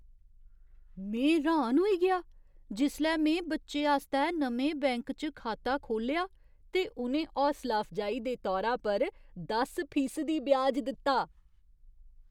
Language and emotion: Dogri, surprised